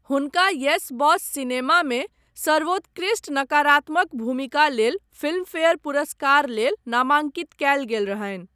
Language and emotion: Maithili, neutral